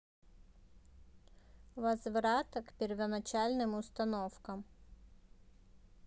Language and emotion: Russian, neutral